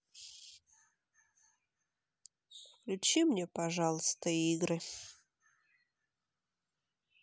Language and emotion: Russian, sad